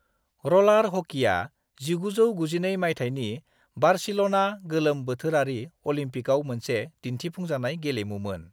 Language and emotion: Bodo, neutral